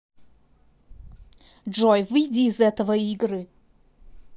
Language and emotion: Russian, angry